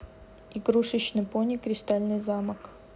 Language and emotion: Russian, neutral